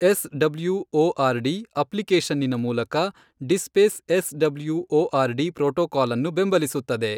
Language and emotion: Kannada, neutral